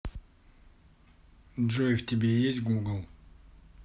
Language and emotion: Russian, neutral